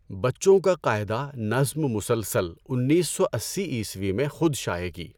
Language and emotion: Urdu, neutral